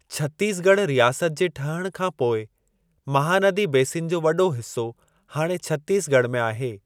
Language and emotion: Sindhi, neutral